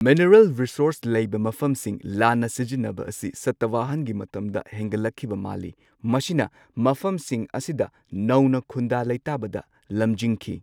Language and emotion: Manipuri, neutral